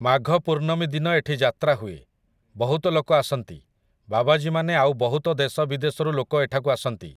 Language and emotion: Odia, neutral